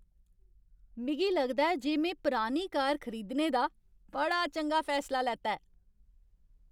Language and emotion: Dogri, happy